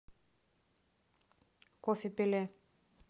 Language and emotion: Russian, neutral